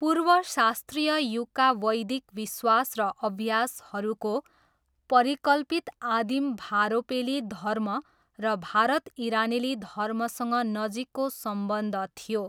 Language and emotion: Nepali, neutral